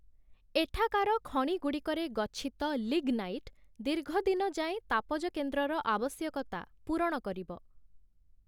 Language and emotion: Odia, neutral